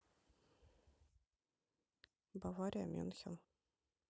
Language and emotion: Russian, neutral